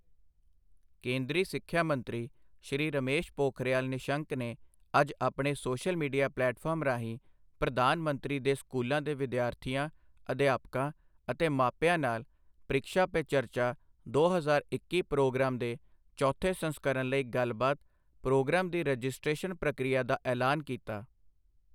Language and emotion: Punjabi, neutral